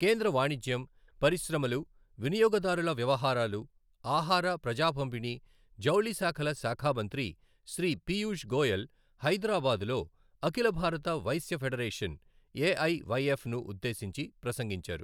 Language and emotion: Telugu, neutral